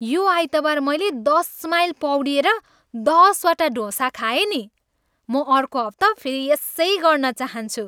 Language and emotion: Nepali, happy